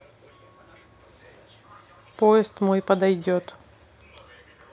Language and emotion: Russian, neutral